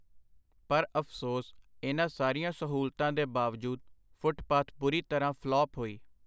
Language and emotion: Punjabi, neutral